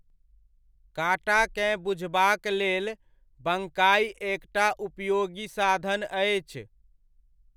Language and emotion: Maithili, neutral